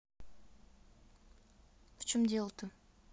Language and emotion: Russian, neutral